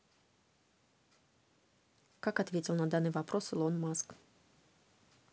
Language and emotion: Russian, neutral